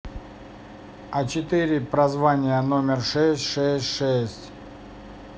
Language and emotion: Russian, neutral